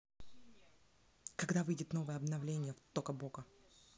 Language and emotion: Russian, neutral